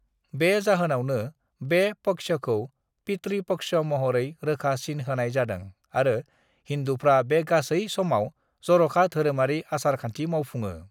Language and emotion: Bodo, neutral